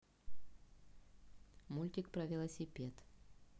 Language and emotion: Russian, neutral